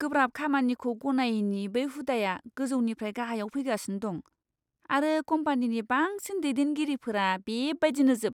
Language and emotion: Bodo, disgusted